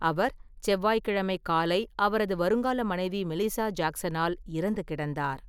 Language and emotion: Tamil, neutral